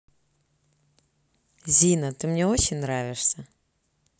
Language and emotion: Russian, positive